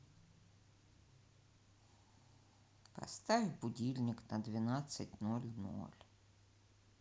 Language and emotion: Russian, sad